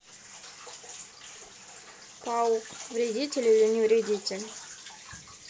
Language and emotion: Russian, neutral